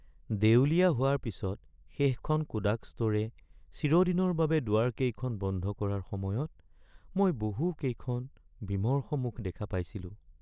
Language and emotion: Assamese, sad